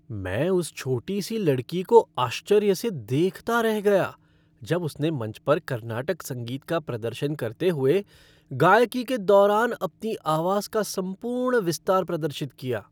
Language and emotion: Hindi, happy